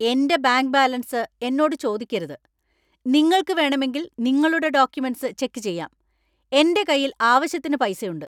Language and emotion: Malayalam, angry